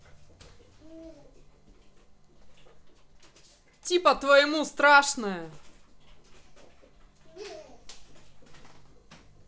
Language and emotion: Russian, neutral